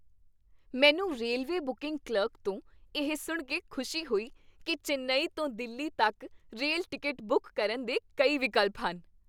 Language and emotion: Punjabi, happy